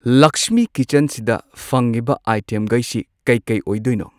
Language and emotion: Manipuri, neutral